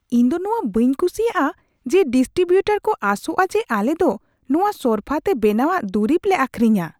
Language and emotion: Santali, disgusted